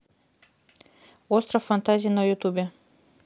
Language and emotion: Russian, neutral